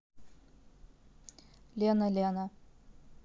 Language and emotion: Russian, neutral